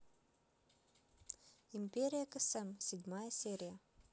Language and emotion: Russian, neutral